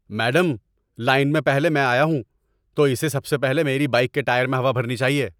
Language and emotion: Urdu, angry